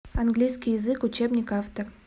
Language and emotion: Russian, neutral